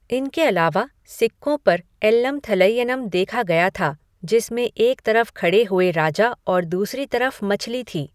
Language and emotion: Hindi, neutral